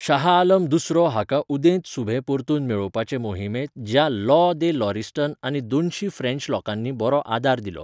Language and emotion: Goan Konkani, neutral